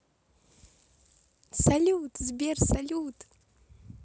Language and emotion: Russian, positive